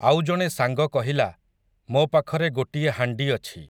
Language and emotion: Odia, neutral